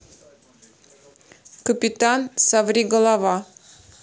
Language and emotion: Russian, neutral